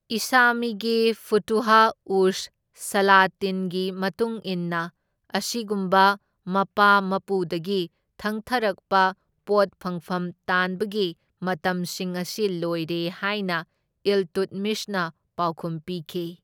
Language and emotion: Manipuri, neutral